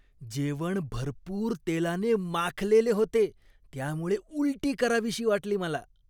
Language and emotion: Marathi, disgusted